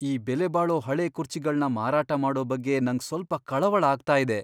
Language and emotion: Kannada, fearful